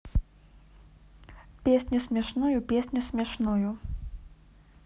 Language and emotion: Russian, neutral